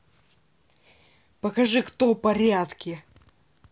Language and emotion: Russian, angry